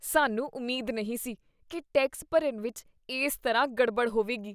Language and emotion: Punjabi, disgusted